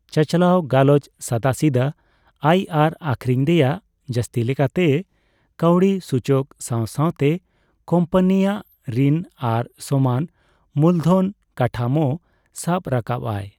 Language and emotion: Santali, neutral